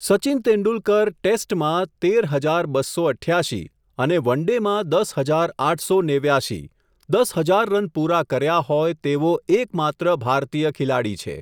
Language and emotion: Gujarati, neutral